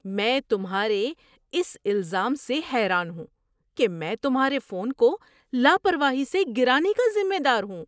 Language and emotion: Urdu, surprised